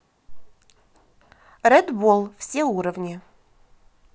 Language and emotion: Russian, positive